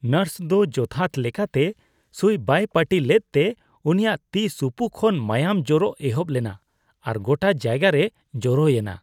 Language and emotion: Santali, disgusted